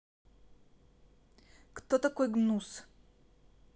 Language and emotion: Russian, neutral